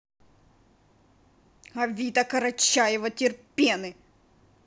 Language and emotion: Russian, angry